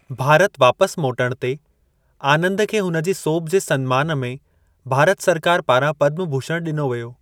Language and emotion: Sindhi, neutral